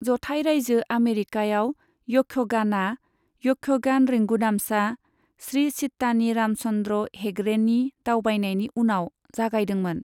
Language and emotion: Bodo, neutral